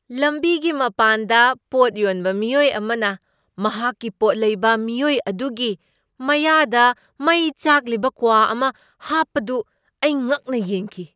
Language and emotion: Manipuri, surprised